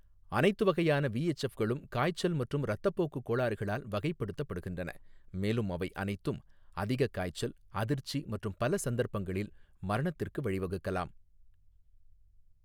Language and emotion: Tamil, neutral